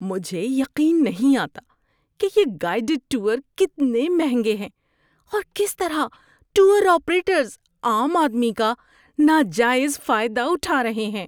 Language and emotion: Urdu, disgusted